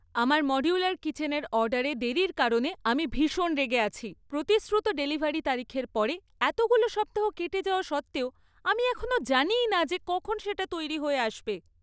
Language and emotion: Bengali, angry